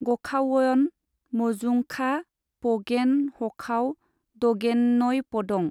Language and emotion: Bodo, neutral